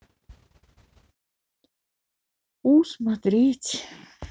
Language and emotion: Russian, sad